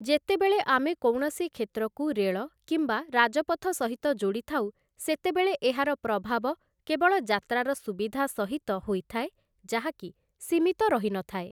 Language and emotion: Odia, neutral